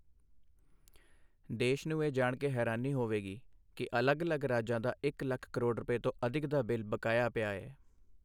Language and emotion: Punjabi, neutral